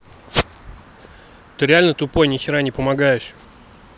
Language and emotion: Russian, angry